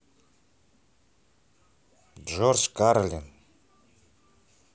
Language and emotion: Russian, neutral